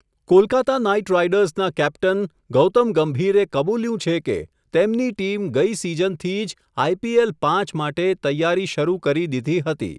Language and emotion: Gujarati, neutral